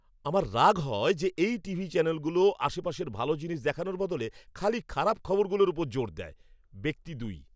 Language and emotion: Bengali, angry